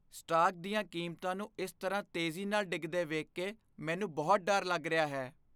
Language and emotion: Punjabi, fearful